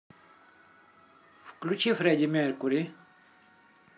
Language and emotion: Russian, neutral